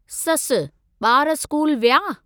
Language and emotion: Sindhi, neutral